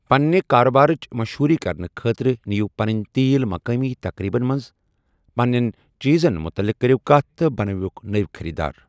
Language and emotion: Kashmiri, neutral